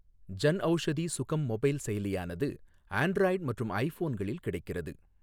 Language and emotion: Tamil, neutral